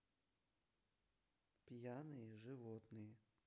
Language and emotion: Russian, neutral